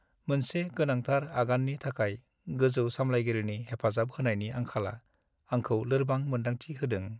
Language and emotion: Bodo, sad